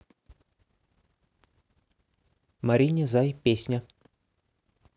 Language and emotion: Russian, neutral